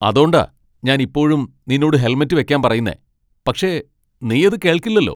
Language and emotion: Malayalam, angry